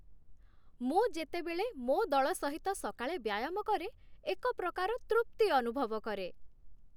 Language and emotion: Odia, happy